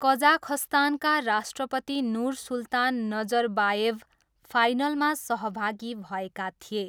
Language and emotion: Nepali, neutral